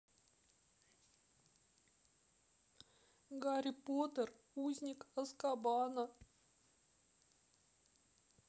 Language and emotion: Russian, sad